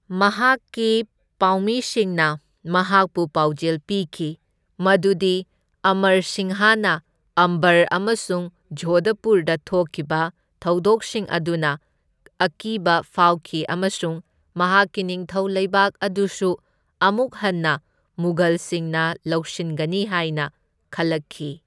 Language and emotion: Manipuri, neutral